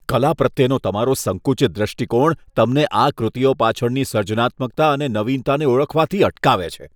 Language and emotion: Gujarati, disgusted